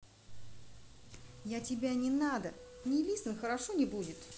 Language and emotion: Russian, angry